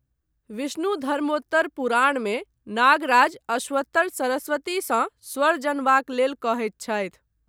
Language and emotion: Maithili, neutral